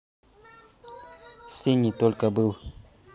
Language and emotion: Russian, neutral